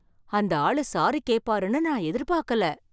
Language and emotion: Tamil, surprised